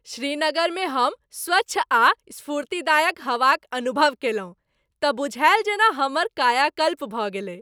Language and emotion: Maithili, happy